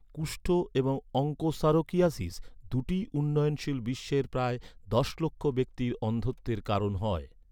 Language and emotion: Bengali, neutral